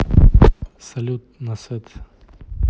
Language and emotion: Russian, neutral